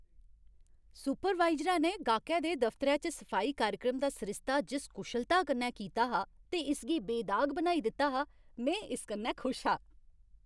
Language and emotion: Dogri, happy